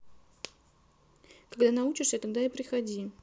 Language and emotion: Russian, neutral